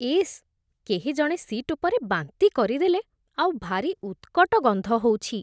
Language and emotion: Odia, disgusted